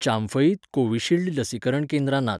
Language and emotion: Goan Konkani, neutral